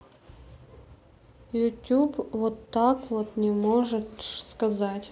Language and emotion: Russian, neutral